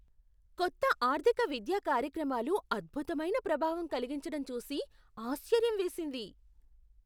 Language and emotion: Telugu, surprised